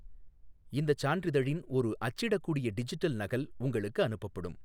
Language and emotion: Tamil, neutral